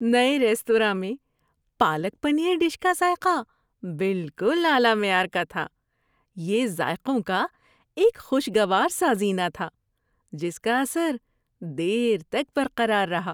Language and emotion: Urdu, happy